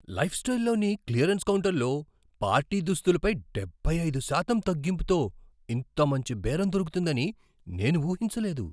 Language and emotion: Telugu, surprised